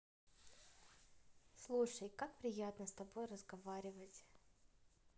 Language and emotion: Russian, positive